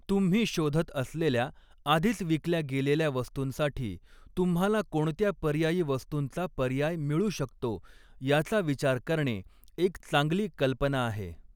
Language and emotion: Marathi, neutral